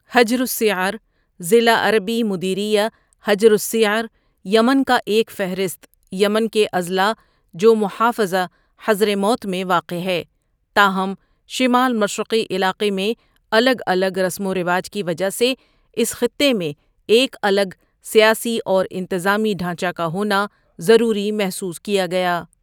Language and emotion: Urdu, neutral